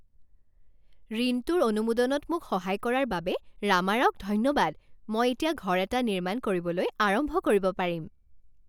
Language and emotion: Assamese, happy